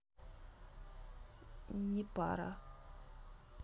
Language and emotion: Russian, neutral